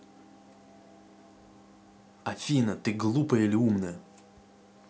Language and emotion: Russian, angry